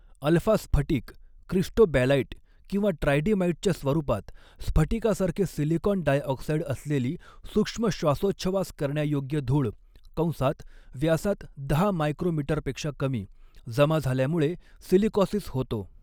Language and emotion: Marathi, neutral